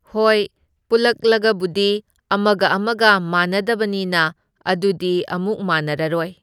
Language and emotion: Manipuri, neutral